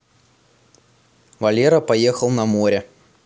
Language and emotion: Russian, neutral